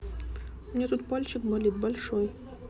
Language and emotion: Russian, neutral